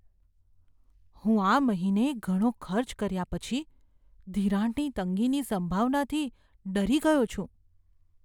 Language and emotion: Gujarati, fearful